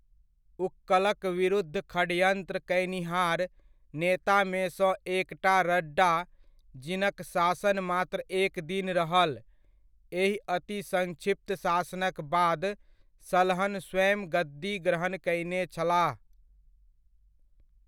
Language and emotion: Maithili, neutral